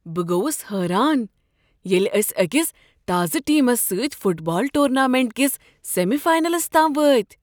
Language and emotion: Kashmiri, surprised